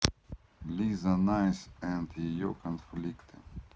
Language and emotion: Russian, neutral